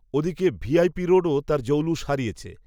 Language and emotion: Bengali, neutral